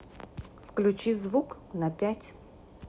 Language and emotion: Russian, neutral